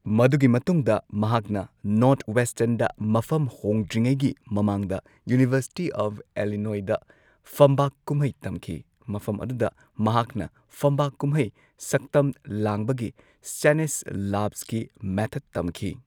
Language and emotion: Manipuri, neutral